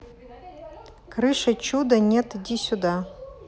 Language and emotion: Russian, neutral